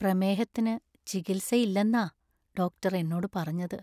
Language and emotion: Malayalam, sad